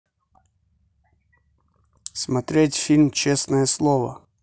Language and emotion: Russian, neutral